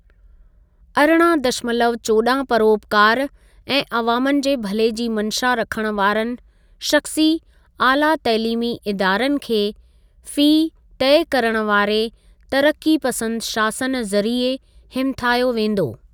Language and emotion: Sindhi, neutral